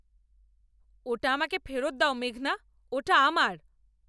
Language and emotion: Bengali, angry